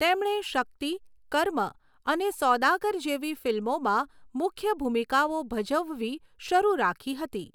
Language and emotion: Gujarati, neutral